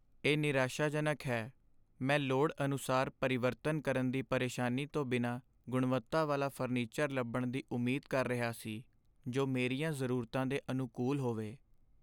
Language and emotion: Punjabi, sad